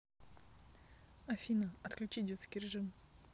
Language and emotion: Russian, neutral